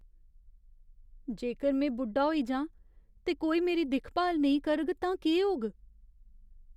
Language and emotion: Dogri, fearful